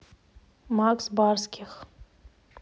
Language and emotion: Russian, neutral